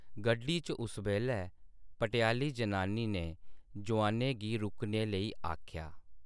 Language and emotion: Dogri, neutral